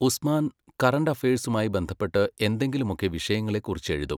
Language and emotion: Malayalam, neutral